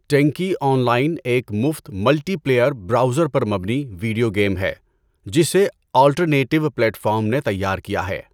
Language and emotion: Urdu, neutral